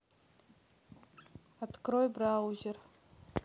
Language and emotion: Russian, neutral